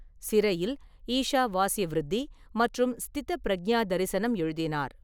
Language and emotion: Tamil, neutral